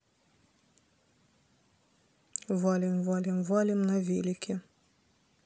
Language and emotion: Russian, neutral